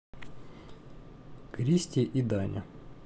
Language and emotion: Russian, neutral